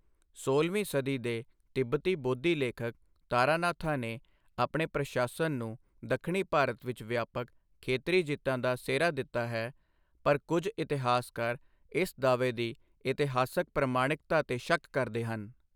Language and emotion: Punjabi, neutral